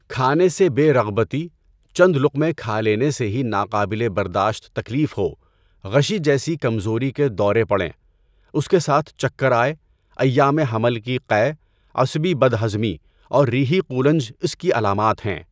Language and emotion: Urdu, neutral